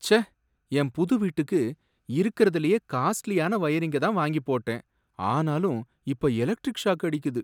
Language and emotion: Tamil, sad